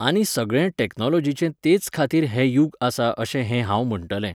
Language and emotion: Goan Konkani, neutral